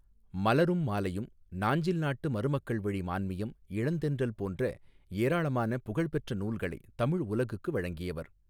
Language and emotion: Tamil, neutral